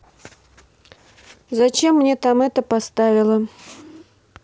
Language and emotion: Russian, neutral